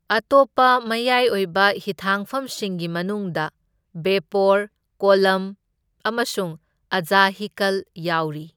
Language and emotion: Manipuri, neutral